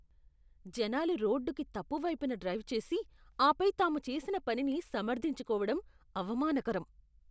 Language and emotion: Telugu, disgusted